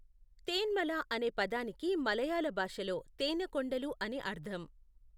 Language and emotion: Telugu, neutral